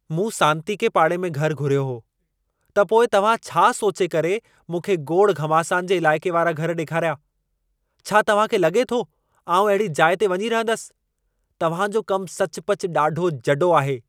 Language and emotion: Sindhi, angry